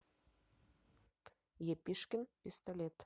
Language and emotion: Russian, neutral